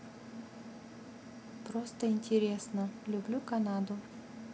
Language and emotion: Russian, neutral